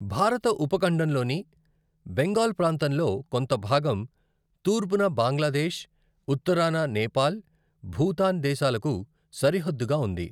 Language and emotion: Telugu, neutral